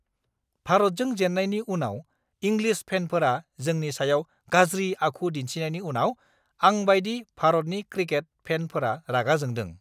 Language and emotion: Bodo, angry